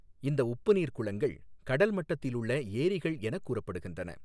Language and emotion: Tamil, neutral